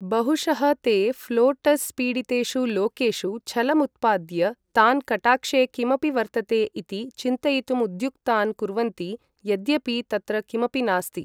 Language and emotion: Sanskrit, neutral